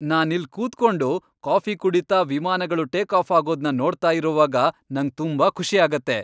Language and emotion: Kannada, happy